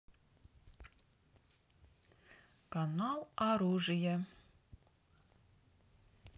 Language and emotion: Russian, neutral